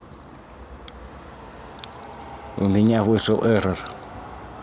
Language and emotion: Russian, neutral